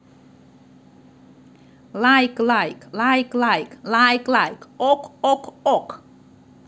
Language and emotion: Russian, positive